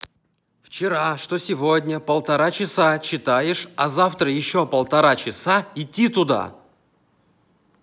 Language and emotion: Russian, angry